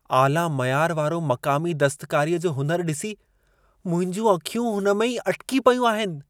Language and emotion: Sindhi, surprised